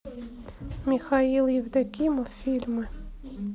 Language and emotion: Russian, neutral